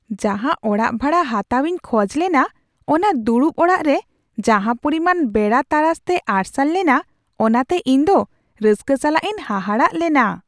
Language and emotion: Santali, surprised